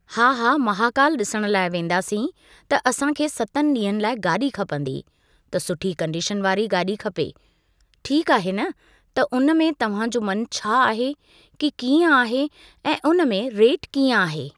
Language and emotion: Sindhi, neutral